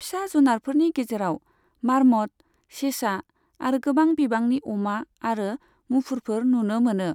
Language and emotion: Bodo, neutral